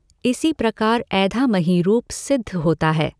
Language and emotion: Hindi, neutral